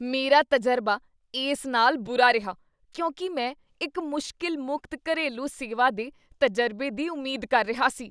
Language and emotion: Punjabi, disgusted